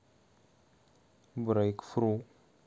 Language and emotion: Russian, neutral